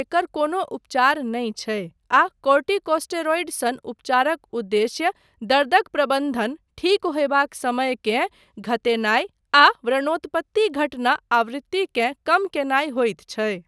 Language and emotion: Maithili, neutral